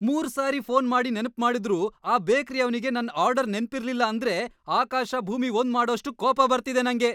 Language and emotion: Kannada, angry